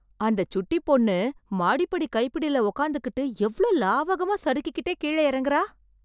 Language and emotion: Tamil, surprised